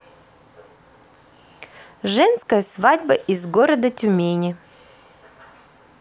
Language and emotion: Russian, neutral